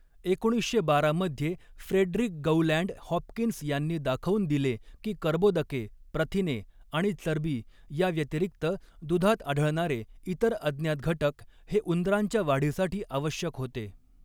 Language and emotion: Marathi, neutral